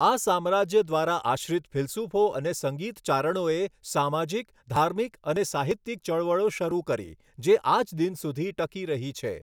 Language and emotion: Gujarati, neutral